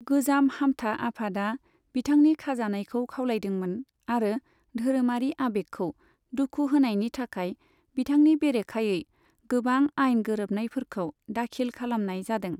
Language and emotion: Bodo, neutral